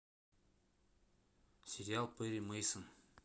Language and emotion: Russian, neutral